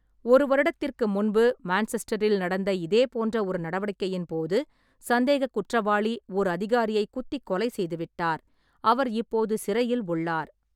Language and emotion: Tamil, neutral